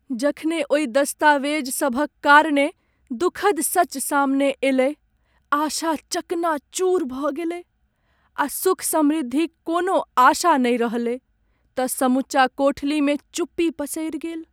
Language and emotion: Maithili, sad